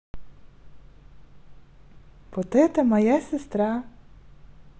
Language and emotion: Russian, positive